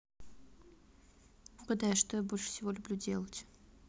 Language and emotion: Russian, neutral